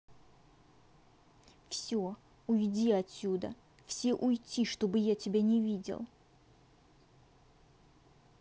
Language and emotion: Russian, angry